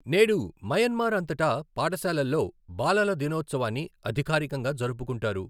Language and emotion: Telugu, neutral